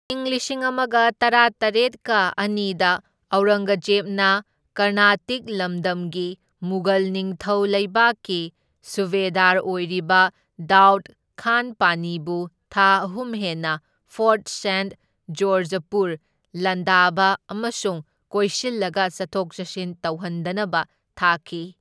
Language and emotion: Manipuri, neutral